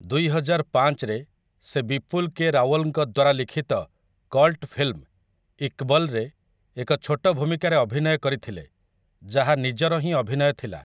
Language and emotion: Odia, neutral